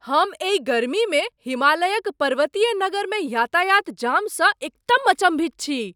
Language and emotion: Maithili, surprised